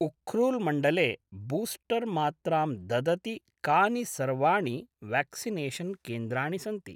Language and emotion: Sanskrit, neutral